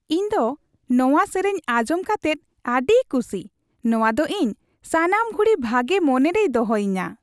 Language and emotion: Santali, happy